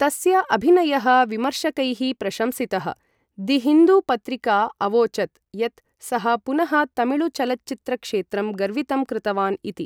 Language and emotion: Sanskrit, neutral